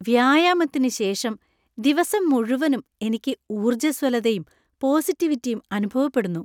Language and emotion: Malayalam, happy